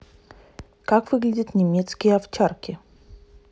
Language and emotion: Russian, neutral